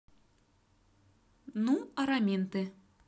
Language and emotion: Russian, positive